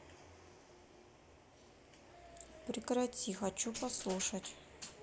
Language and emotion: Russian, neutral